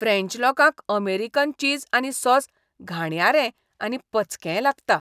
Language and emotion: Goan Konkani, disgusted